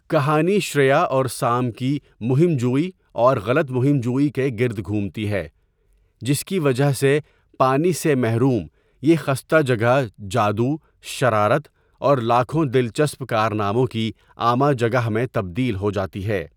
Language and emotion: Urdu, neutral